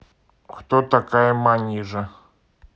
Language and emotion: Russian, neutral